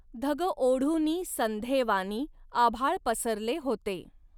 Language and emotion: Marathi, neutral